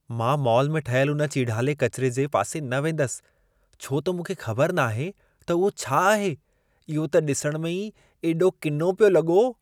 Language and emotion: Sindhi, disgusted